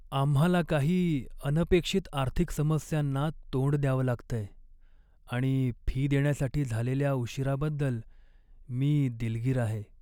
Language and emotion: Marathi, sad